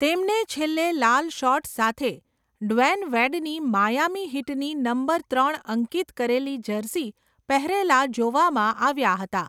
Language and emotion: Gujarati, neutral